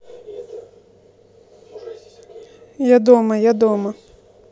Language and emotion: Russian, neutral